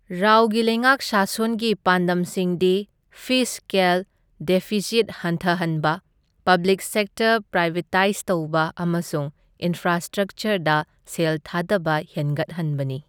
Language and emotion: Manipuri, neutral